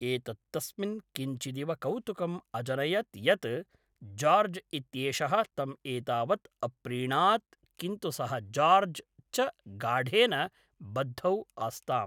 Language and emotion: Sanskrit, neutral